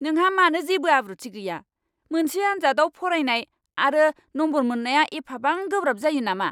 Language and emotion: Bodo, angry